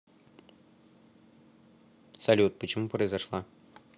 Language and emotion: Russian, neutral